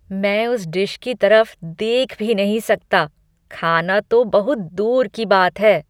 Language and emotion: Hindi, disgusted